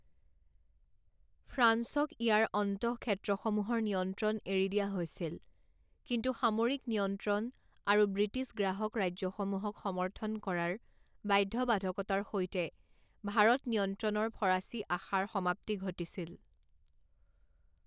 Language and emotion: Assamese, neutral